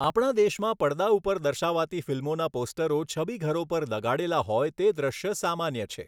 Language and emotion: Gujarati, neutral